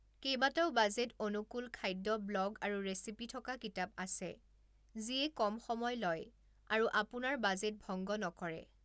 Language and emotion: Assamese, neutral